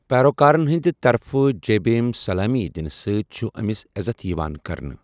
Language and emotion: Kashmiri, neutral